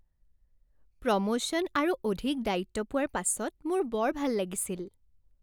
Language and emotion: Assamese, happy